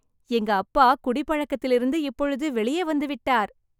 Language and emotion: Tamil, happy